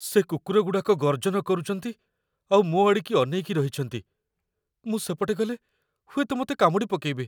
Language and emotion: Odia, fearful